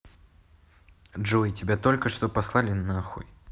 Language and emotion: Russian, neutral